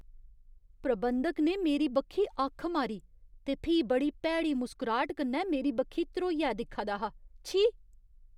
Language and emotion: Dogri, disgusted